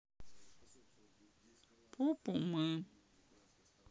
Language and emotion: Russian, sad